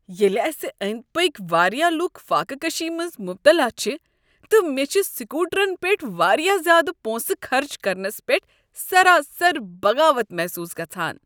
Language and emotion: Kashmiri, disgusted